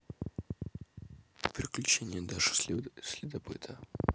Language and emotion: Russian, neutral